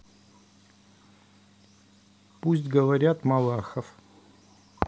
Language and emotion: Russian, neutral